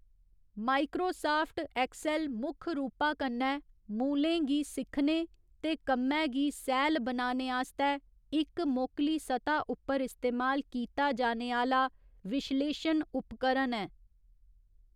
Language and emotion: Dogri, neutral